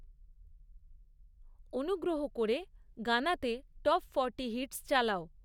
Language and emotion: Bengali, neutral